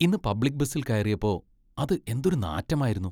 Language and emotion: Malayalam, disgusted